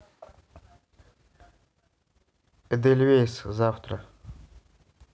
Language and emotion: Russian, neutral